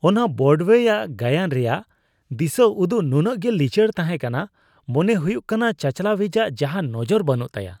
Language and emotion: Santali, disgusted